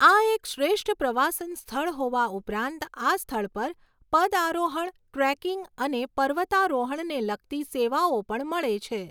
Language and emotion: Gujarati, neutral